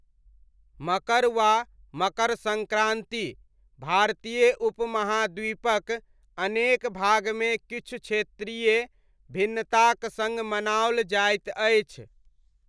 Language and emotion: Maithili, neutral